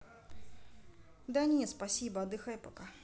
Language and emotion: Russian, neutral